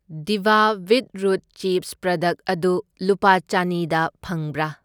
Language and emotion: Manipuri, neutral